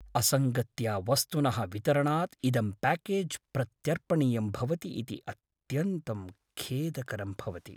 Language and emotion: Sanskrit, sad